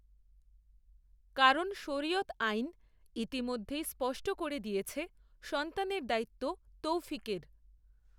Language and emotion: Bengali, neutral